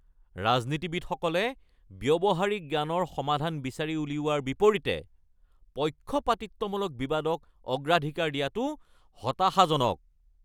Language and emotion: Assamese, angry